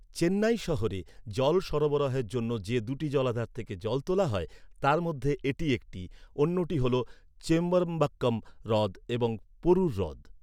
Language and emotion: Bengali, neutral